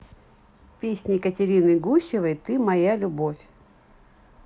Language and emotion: Russian, neutral